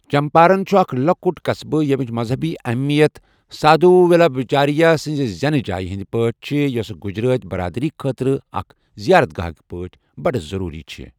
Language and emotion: Kashmiri, neutral